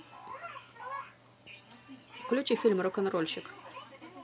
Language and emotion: Russian, positive